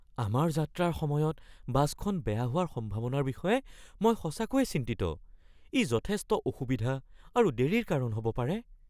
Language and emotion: Assamese, fearful